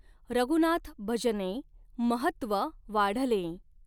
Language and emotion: Marathi, neutral